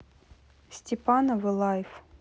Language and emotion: Russian, neutral